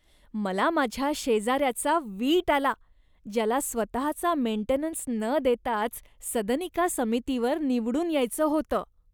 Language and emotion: Marathi, disgusted